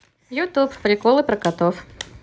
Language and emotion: Russian, positive